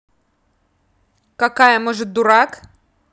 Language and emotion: Russian, angry